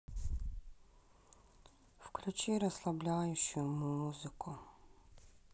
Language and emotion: Russian, sad